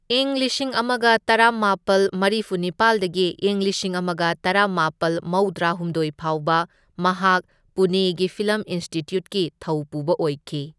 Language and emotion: Manipuri, neutral